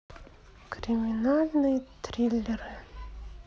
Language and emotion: Russian, sad